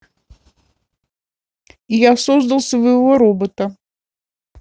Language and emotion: Russian, neutral